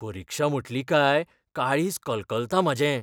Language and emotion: Goan Konkani, fearful